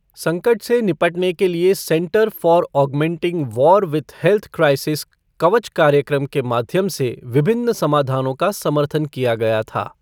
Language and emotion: Hindi, neutral